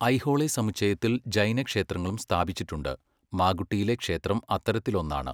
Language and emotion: Malayalam, neutral